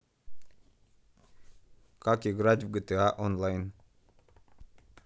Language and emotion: Russian, neutral